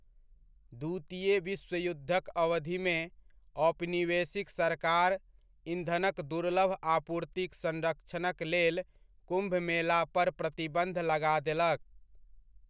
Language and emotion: Maithili, neutral